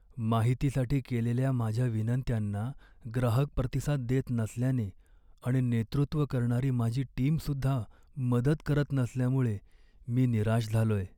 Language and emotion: Marathi, sad